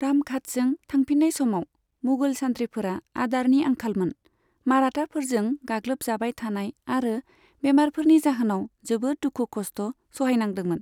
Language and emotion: Bodo, neutral